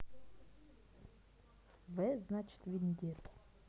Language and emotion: Russian, neutral